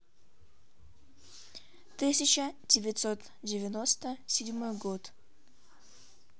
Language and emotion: Russian, neutral